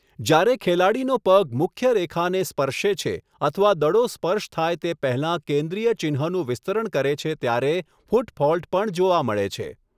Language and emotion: Gujarati, neutral